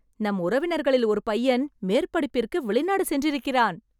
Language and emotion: Tamil, happy